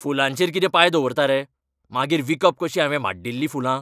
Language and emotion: Goan Konkani, angry